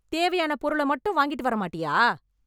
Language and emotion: Tamil, angry